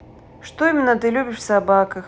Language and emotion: Russian, neutral